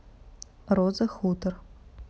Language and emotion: Russian, neutral